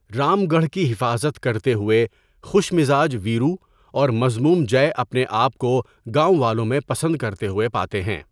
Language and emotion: Urdu, neutral